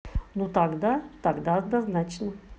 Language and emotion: Russian, neutral